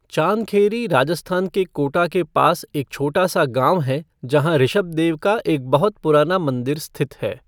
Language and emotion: Hindi, neutral